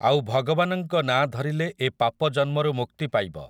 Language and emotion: Odia, neutral